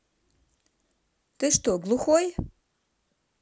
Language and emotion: Russian, neutral